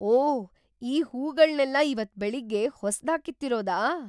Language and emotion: Kannada, surprised